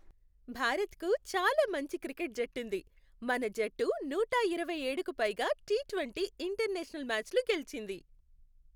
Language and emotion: Telugu, happy